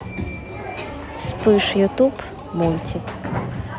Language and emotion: Russian, neutral